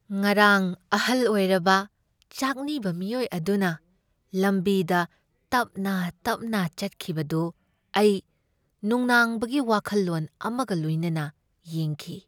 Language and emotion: Manipuri, sad